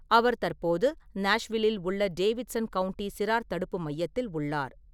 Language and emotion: Tamil, neutral